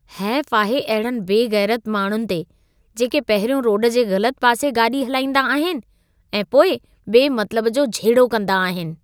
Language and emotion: Sindhi, disgusted